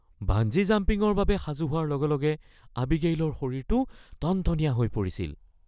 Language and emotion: Assamese, fearful